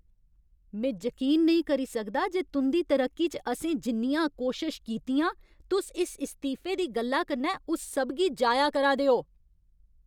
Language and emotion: Dogri, angry